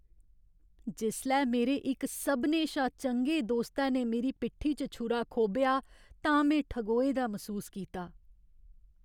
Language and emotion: Dogri, sad